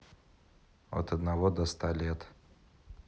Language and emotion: Russian, neutral